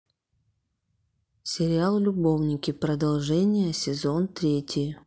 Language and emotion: Russian, neutral